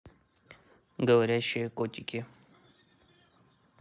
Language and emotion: Russian, neutral